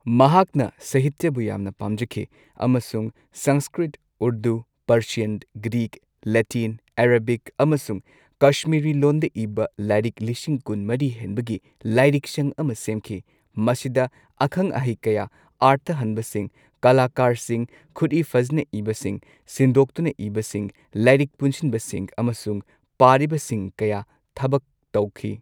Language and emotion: Manipuri, neutral